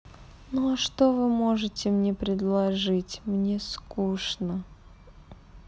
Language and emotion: Russian, sad